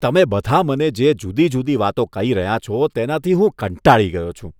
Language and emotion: Gujarati, disgusted